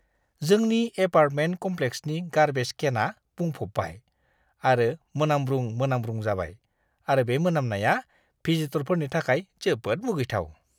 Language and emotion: Bodo, disgusted